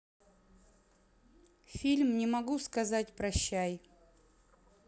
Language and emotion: Russian, neutral